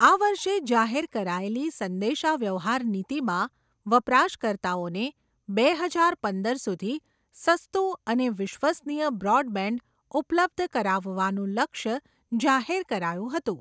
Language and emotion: Gujarati, neutral